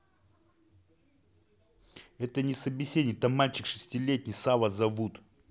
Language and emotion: Russian, angry